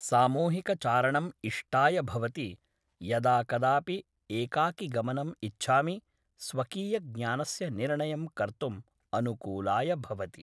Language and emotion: Sanskrit, neutral